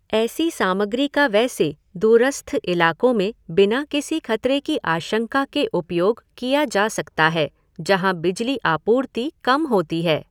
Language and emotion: Hindi, neutral